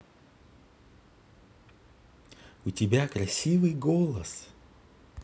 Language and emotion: Russian, positive